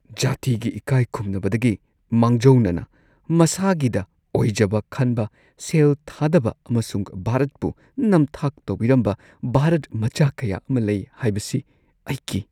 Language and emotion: Manipuri, fearful